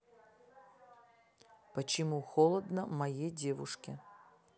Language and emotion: Russian, neutral